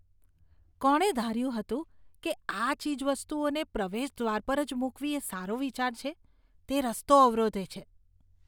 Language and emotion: Gujarati, disgusted